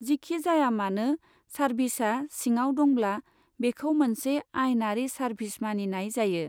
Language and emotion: Bodo, neutral